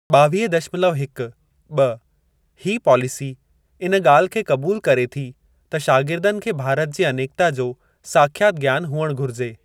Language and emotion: Sindhi, neutral